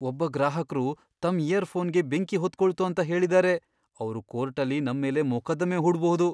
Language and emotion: Kannada, fearful